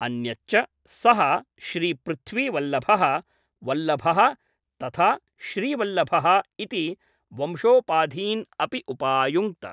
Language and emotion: Sanskrit, neutral